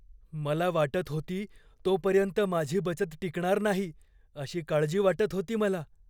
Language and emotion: Marathi, fearful